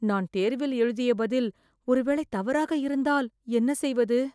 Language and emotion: Tamil, fearful